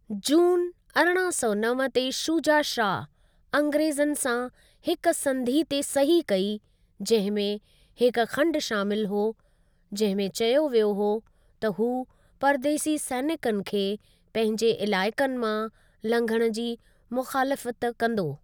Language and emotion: Sindhi, neutral